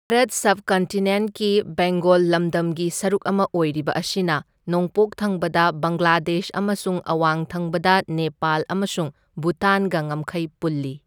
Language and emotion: Manipuri, neutral